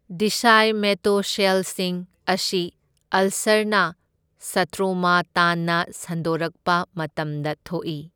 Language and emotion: Manipuri, neutral